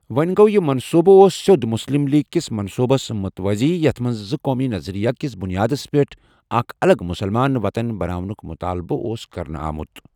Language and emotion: Kashmiri, neutral